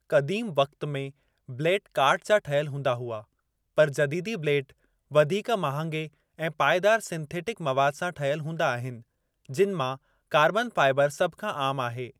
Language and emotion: Sindhi, neutral